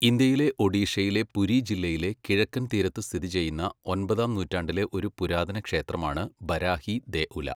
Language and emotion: Malayalam, neutral